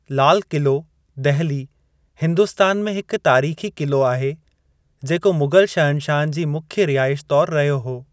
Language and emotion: Sindhi, neutral